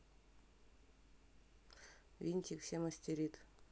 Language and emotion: Russian, neutral